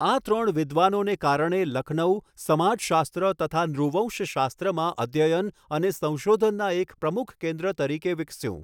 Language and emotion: Gujarati, neutral